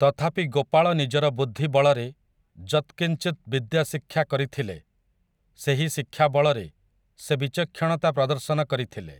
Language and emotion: Odia, neutral